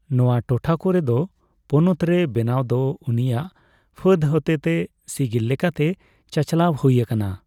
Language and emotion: Santali, neutral